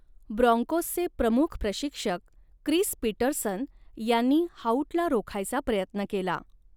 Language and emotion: Marathi, neutral